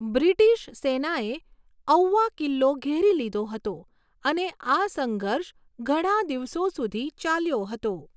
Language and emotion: Gujarati, neutral